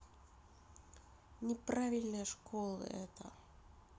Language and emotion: Russian, neutral